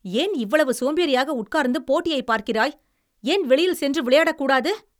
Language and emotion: Tamil, angry